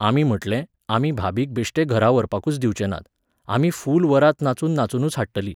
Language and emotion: Goan Konkani, neutral